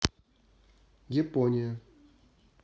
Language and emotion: Russian, neutral